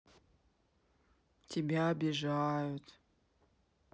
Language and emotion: Russian, sad